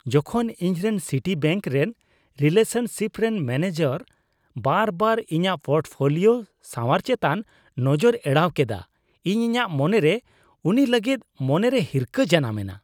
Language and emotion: Santali, disgusted